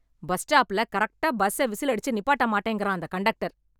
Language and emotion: Tamil, angry